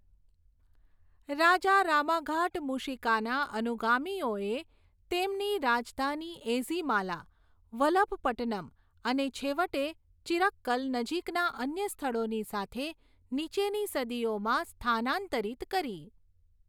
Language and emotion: Gujarati, neutral